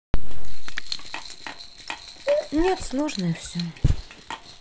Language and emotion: Russian, sad